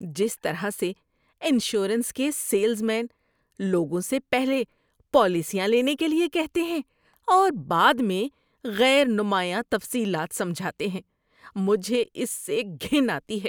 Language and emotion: Urdu, disgusted